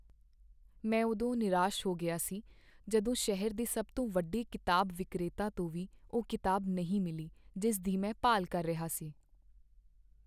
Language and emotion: Punjabi, sad